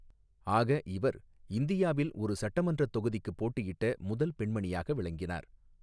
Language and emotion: Tamil, neutral